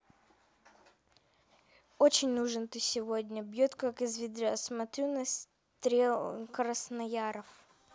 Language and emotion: Russian, neutral